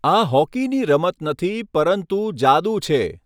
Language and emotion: Gujarati, neutral